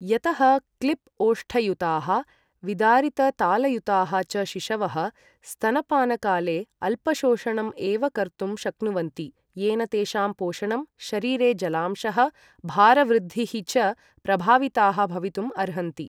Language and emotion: Sanskrit, neutral